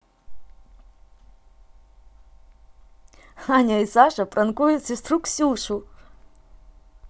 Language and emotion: Russian, positive